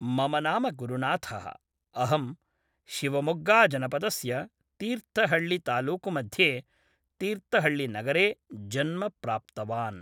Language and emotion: Sanskrit, neutral